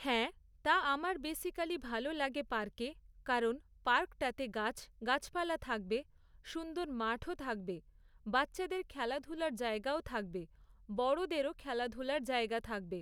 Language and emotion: Bengali, neutral